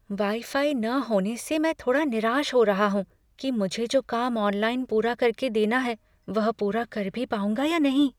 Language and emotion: Hindi, fearful